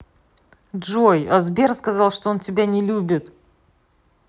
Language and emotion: Russian, neutral